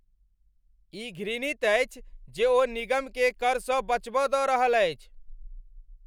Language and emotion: Maithili, angry